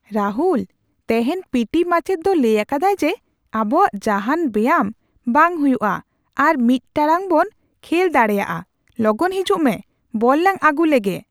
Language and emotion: Santali, surprised